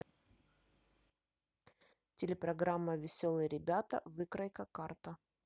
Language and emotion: Russian, neutral